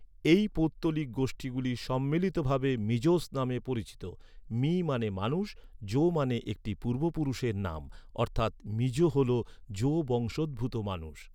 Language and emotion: Bengali, neutral